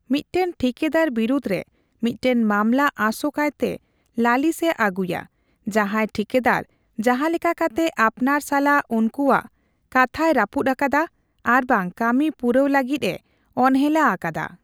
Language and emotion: Santali, neutral